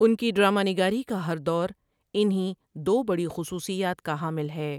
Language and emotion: Urdu, neutral